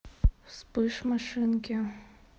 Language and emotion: Russian, sad